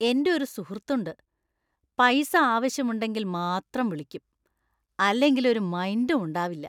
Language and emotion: Malayalam, disgusted